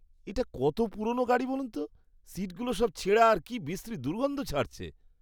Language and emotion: Bengali, disgusted